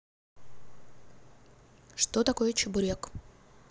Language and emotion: Russian, neutral